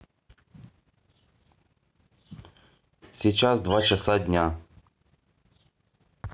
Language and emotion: Russian, neutral